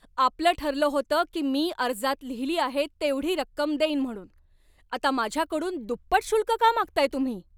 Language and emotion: Marathi, angry